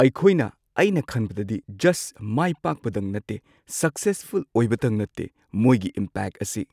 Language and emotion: Manipuri, neutral